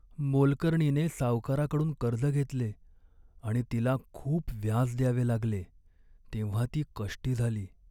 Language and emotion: Marathi, sad